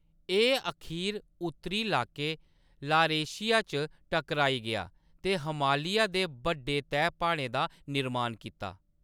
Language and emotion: Dogri, neutral